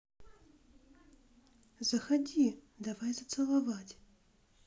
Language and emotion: Russian, neutral